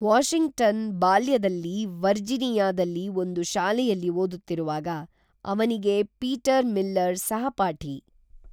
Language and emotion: Kannada, neutral